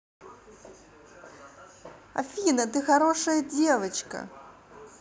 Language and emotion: Russian, positive